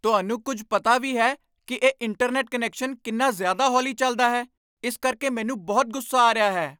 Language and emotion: Punjabi, angry